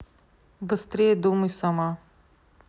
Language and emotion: Russian, neutral